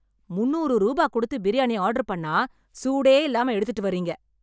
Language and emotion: Tamil, angry